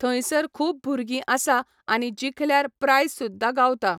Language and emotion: Goan Konkani, neutral